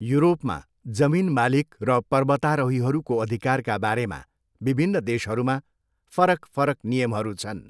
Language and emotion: Nepali, neutral